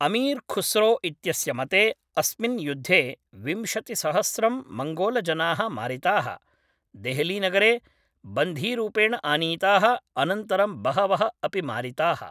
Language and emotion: Sanskrit, neutral